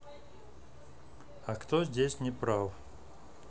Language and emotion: Russian, neutral